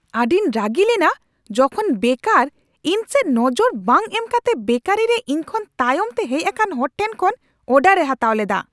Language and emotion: Santali, angry